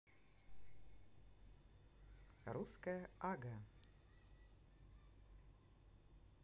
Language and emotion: Russian, positive